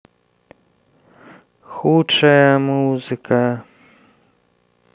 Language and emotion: Russian, sad